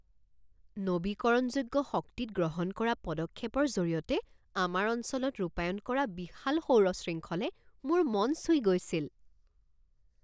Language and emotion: Assamese, surprised